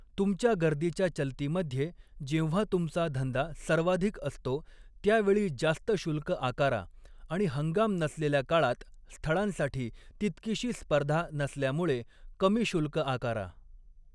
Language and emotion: Marathi, neutral